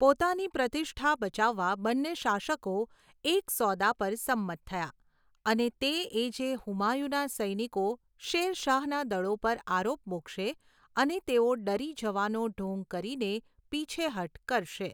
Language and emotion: Gujarati, neutral